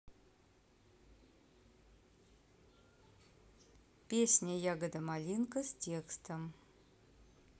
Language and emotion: Russian, neutral